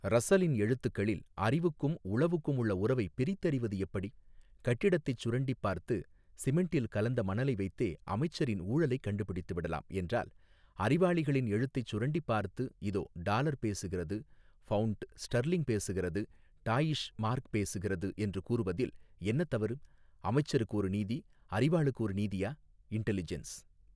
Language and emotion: Tamil, neutral